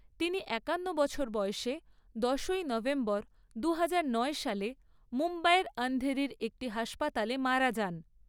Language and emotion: Bengali, neutral